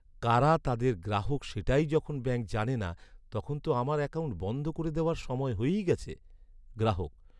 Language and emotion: Bengali, sad